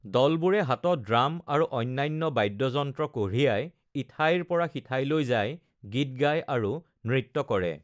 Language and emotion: Assamese, neutral